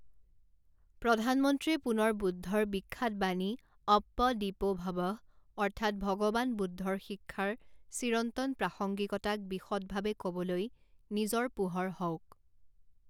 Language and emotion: Assamese, neutral